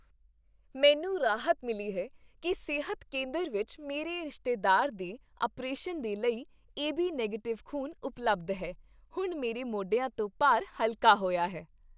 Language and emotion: Punjabi, happy